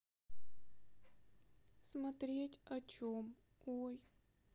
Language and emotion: Russian, sad